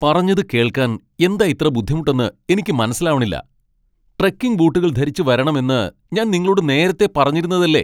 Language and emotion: Malayalam, angry